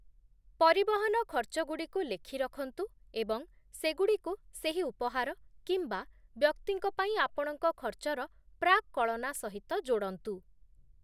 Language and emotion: Odia, neutral